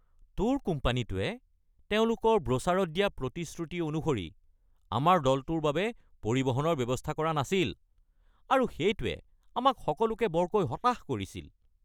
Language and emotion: Assamese, angry